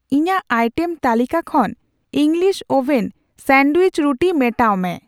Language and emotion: Santali, neutral